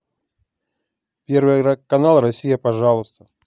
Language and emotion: Russian, neutral